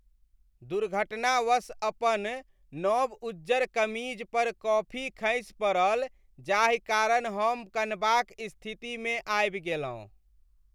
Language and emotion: Maithili, sad